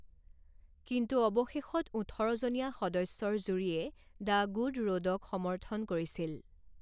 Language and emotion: Assamese, neutral